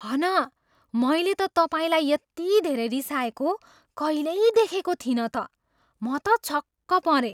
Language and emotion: Nepali, surprised